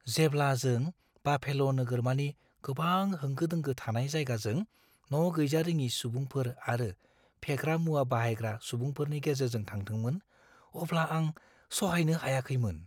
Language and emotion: Bodo, fearful